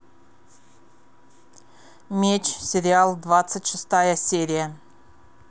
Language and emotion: Russian, neutral